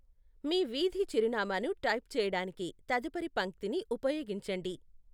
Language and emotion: Telugu, neutral